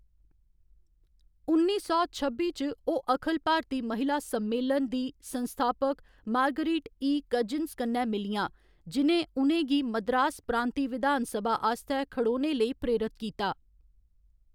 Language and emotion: Dogri, neutral